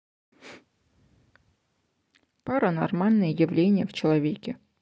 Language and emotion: Russian, neutral